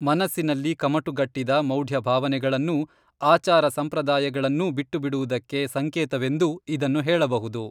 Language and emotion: Kannada, neutral